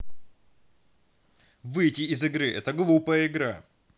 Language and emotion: Russian, angry